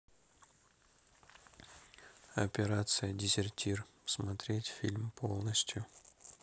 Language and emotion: Russian, neutral